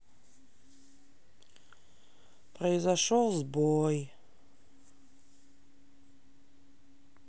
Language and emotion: Russian, sad